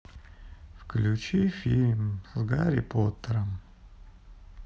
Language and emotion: Russian, sad